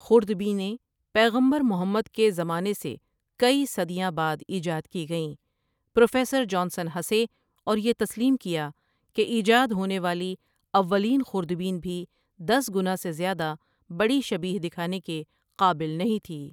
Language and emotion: Urdu, neutral